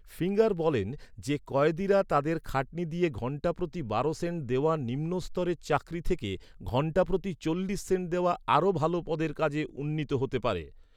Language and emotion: Bengali, neutral